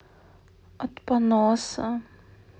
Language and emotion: Russian, sad